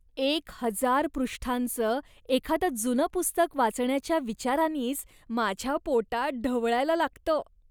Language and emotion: Marathi, disgusted